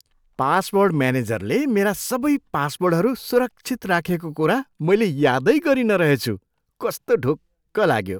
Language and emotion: Nepali, surprised